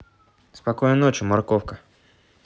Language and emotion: Russian, neutral